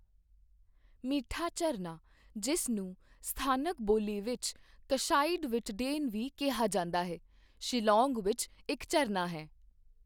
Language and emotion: Punjabi, neutral